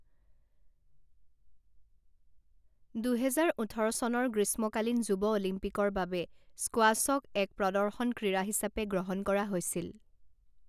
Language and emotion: Assamese, neutral